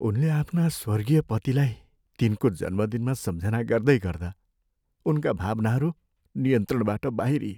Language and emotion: Nepali, sad